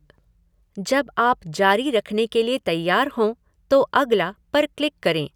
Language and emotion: Hindi, neutral